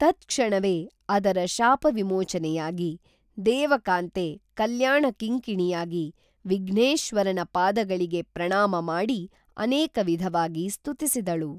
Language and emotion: Kannada, neutral